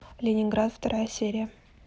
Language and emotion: Russian, neutral